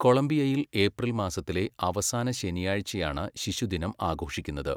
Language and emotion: Malayalam, neutral